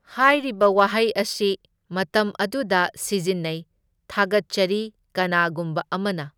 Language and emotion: Manipuri, neutral